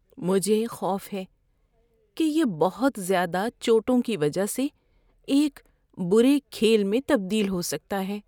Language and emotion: Urdu, fearful